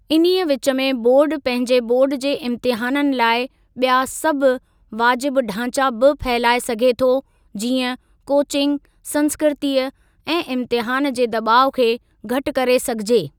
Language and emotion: Sindhi, neutral